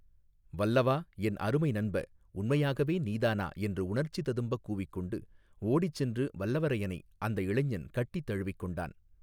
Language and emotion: Tamil, neutral